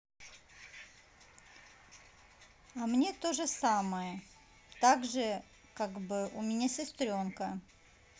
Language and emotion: Russian, neutral